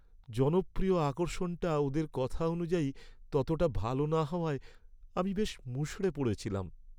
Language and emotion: Bengali, sad